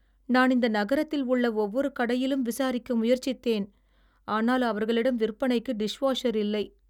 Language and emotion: Tamil, sad